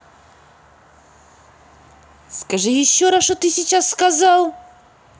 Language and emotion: Russian, angry